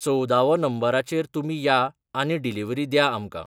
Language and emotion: Goan Konkani, neutral